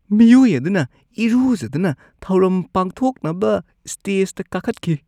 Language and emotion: Manipuri, disgusted